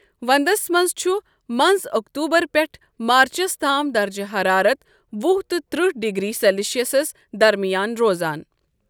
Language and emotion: Kashmiri, neutral